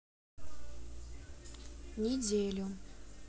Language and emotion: Russian, neutral